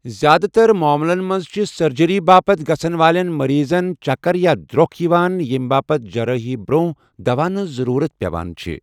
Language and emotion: Kashmiri, neutral